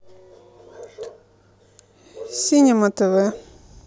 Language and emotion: Russian, neutral